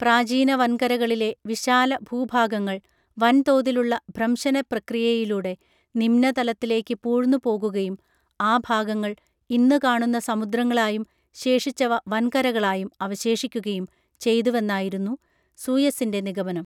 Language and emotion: Malayalam, neutral